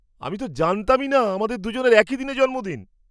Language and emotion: Bengali, surprised